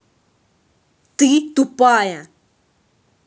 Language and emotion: Russian, angry